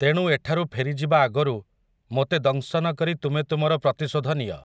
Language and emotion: Odia, neutral